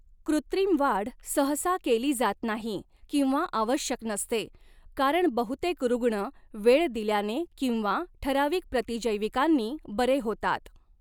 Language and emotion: Marathi, neutral